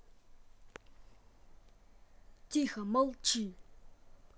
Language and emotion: Russian, angry